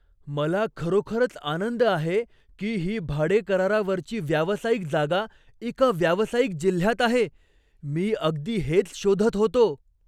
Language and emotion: Marathi, surprised